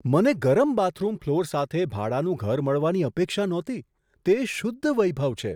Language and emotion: Gujarati, surprised